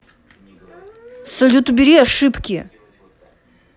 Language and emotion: Russian, angry